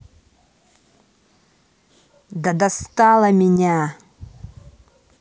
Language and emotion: Russian, angry